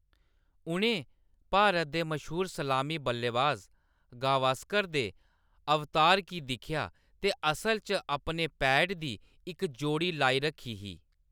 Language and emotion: Dogri, neutral